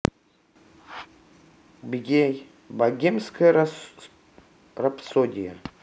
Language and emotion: Russian, neutral